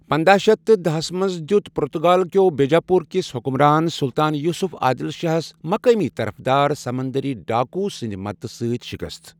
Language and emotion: Kashmiri, neutral